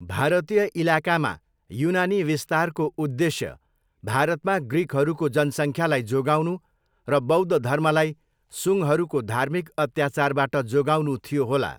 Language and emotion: Nepali, neutral